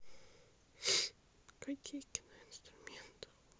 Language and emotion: Russian, sad